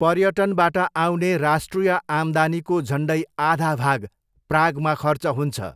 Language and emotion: Nepali, neutral